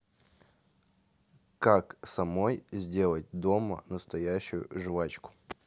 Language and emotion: Russian, neutral